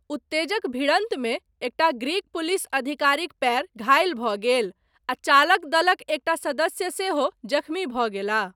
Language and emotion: Maithili, neutral